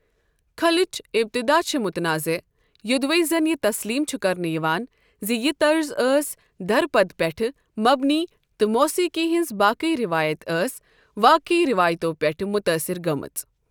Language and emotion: Kashmiri, neutral